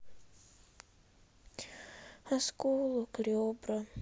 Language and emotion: Russian, sad